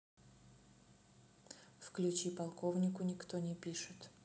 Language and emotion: Russian, neutral